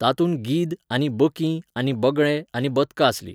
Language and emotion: Goan Konkani, neutral